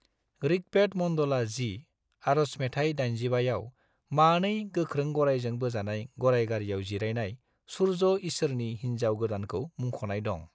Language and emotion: Bodo, neutral